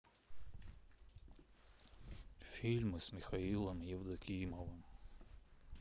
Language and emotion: Russian, sad